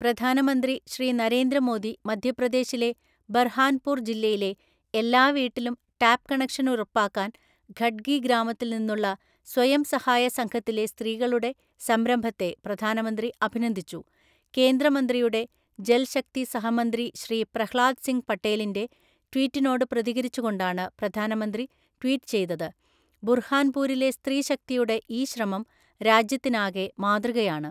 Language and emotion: Malayalam, neutral